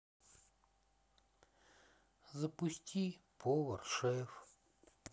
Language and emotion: Russian, sad